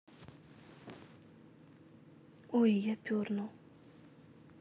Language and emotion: Russian, neutral